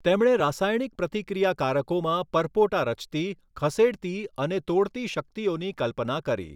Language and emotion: Gujarati, neutral